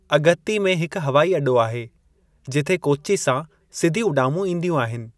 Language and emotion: Sindhi, neutral